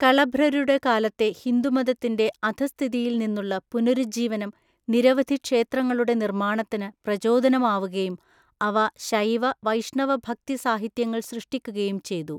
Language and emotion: Malayalam, neutral